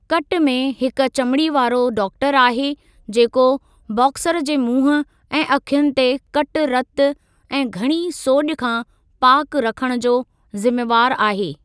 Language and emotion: Sindhi, neutral